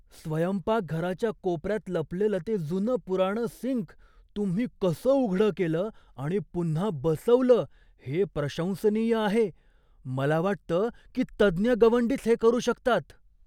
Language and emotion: Marathi, surprised